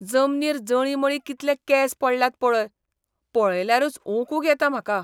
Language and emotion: Goan Konkani, disgusted